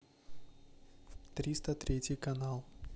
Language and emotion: Russian, neutral